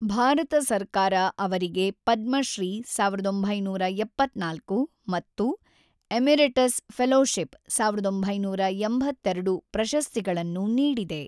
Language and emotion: Kannada, neutral